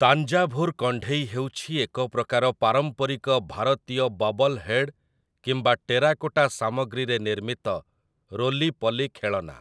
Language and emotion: Odia, neutral